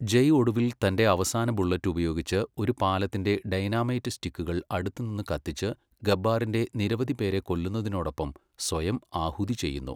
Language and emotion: Malayalam, neutral